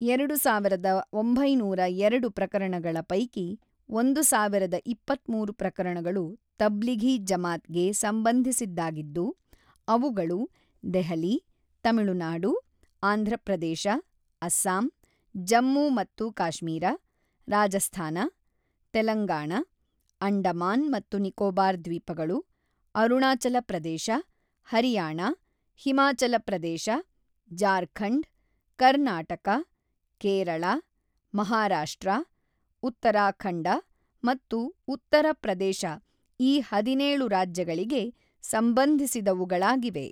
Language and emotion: Kannada, neutral